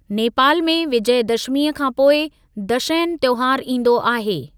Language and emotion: Sindhi, neutral